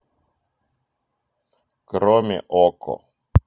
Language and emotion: Russian, neutral